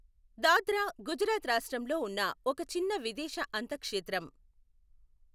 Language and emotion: Telugu, neutral